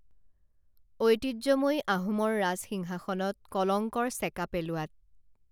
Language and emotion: Assamese, neutral